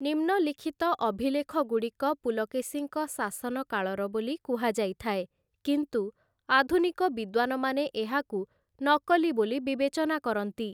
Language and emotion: Odia, neutral